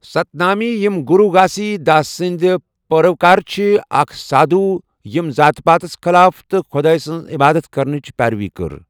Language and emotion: Kashmiri, neutral